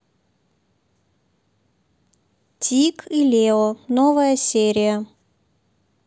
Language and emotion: Russian, neutral